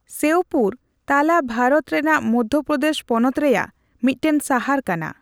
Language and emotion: Santali, neutral